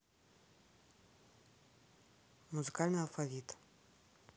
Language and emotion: Russian, neutral